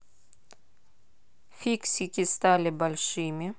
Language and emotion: Russian, neutral